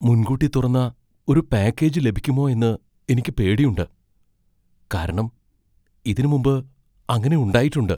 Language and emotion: Malayalam, fearful